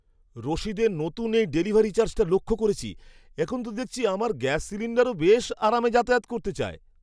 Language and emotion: Bengali, surprised